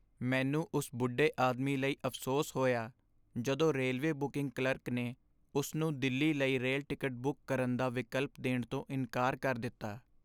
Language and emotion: Punjabi, sad